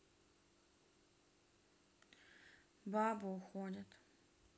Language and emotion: Russian, sad